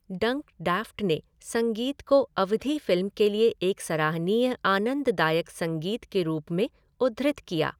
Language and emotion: Hindi, neutral